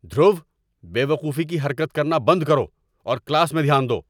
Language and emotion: Urdu, angry